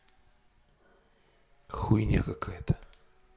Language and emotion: Russian, angry